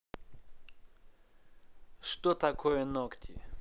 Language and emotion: Russian, neutral